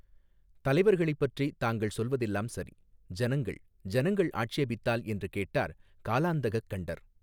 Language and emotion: Tamil, neutral